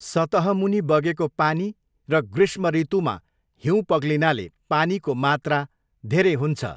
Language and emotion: Nepali, neutral